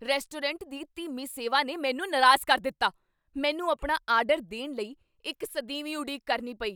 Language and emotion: Punjabi, angry